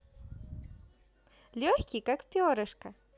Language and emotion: Russian, positive